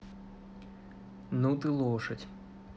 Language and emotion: Russian, neutral